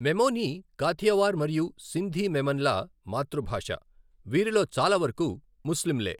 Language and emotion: Telugu, neutral